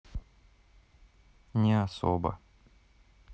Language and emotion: Russian, sad